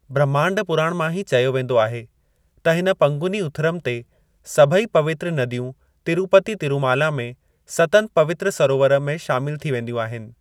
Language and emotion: Sindhi, neutral